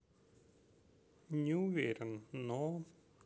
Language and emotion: Russian, neutral